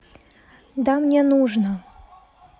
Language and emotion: Russian, neutral